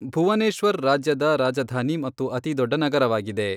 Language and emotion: Kannada, neutral